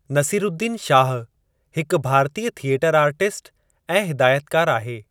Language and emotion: Sindhi, neutral